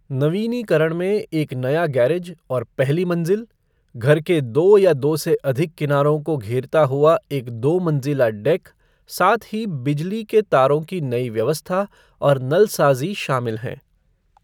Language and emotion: Hindi, neutral